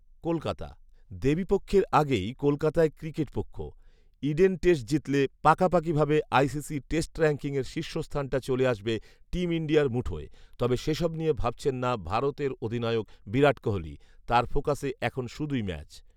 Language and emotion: Bengali, neutral